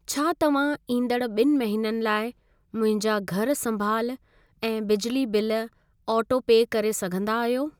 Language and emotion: Sindhi, neutral